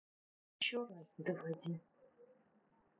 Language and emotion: Russian, neutral